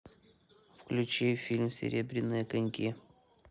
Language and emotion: Russian, neutral